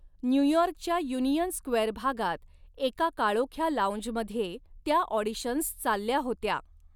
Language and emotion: Marathi, neutral